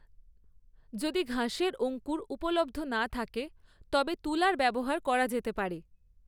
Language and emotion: Bengali, neutral